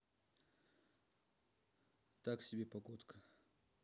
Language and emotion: Russian, neutral